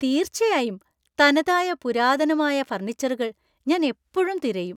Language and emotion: Malayalam, happy